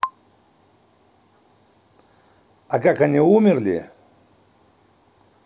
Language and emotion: Russian, neutral